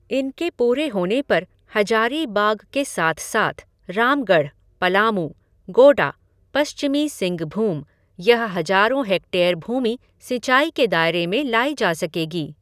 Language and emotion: Hindi, neutral